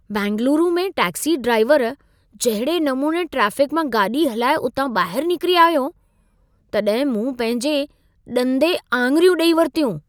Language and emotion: Sindhi, surprised